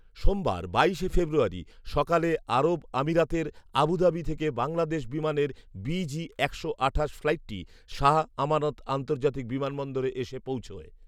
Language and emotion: Bengali, neutral